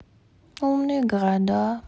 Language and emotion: Russian, sad